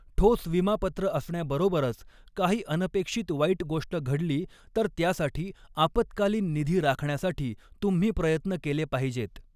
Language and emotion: Marathi, neutral